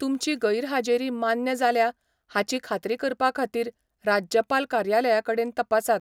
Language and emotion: Goan Konkani, neutral